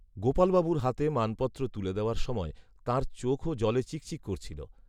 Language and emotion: Bengali, neutral